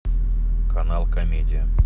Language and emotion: Russian, neutral